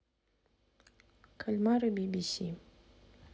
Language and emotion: Russian, neutral